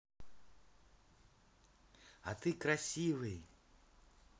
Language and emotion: Russian, positive